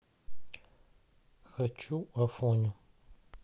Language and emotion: Russian, neutral